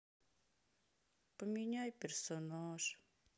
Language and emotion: Russian, sad